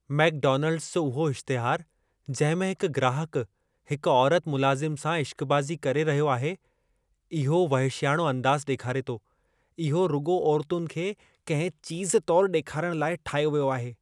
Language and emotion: Sindhi, disgusted